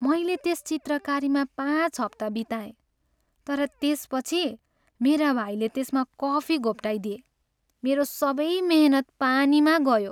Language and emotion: Nepali, sad